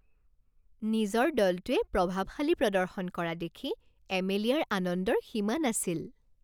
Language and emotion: Assamese, happy